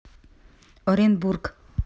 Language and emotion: Russian, neutral